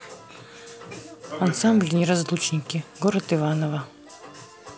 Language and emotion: Russian, neutral